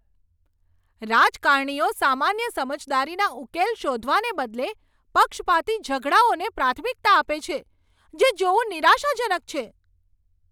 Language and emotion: Gujarati, angry